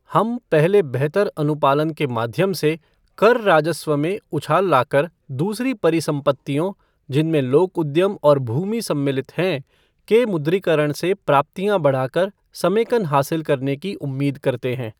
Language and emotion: Hindi, neutral